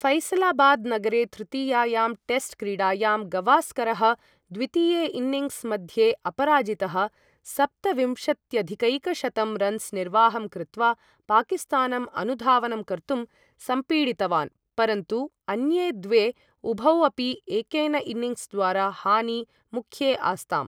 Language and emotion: Sanskrit, neutral